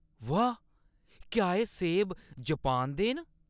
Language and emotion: Dogri, surprised